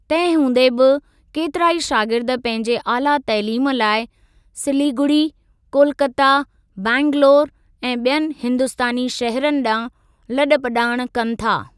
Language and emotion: Sindhi, neutral